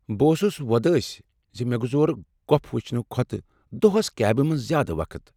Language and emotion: Kashmiri, sad